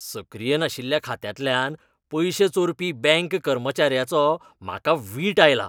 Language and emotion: Goan Konkani, disgusted